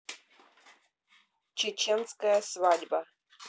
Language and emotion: Russian, neutral